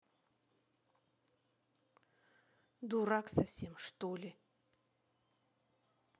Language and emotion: Russian, angry